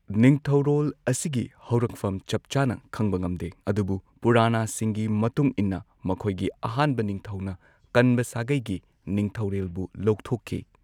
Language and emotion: Manipuri, neutral